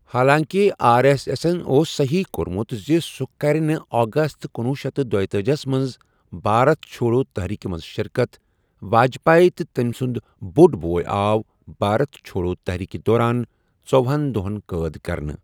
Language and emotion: Kashmiri, neutral